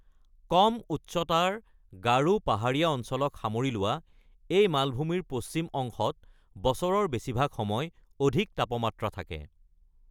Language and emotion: Assamese, neutral